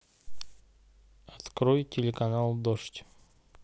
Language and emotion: Russian, neutral